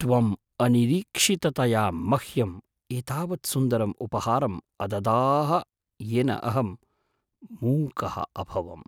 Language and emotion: Sanskrit, surprised